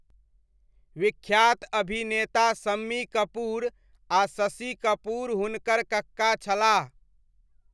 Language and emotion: Maithili, neutral